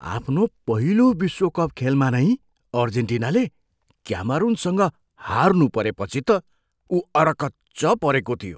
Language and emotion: Nepali, surprised